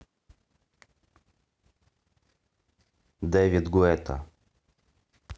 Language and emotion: Russian, neutral